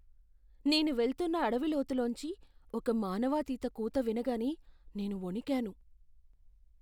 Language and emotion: Telugu, fearful